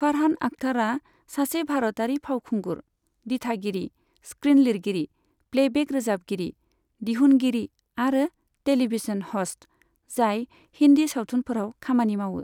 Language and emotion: Bodo, neutral